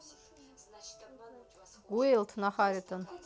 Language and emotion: Russian, neutral